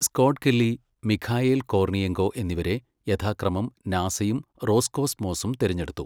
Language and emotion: Malayalam, neutral